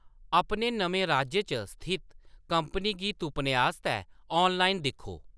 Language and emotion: Dogri, neutral